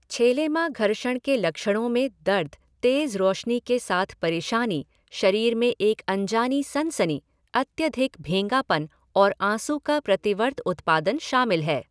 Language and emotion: Hindi, neutral